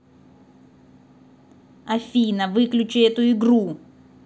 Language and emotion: Russian, angry